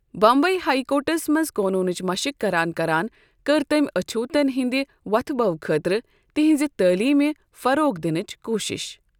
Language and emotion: Kashmiri, neutral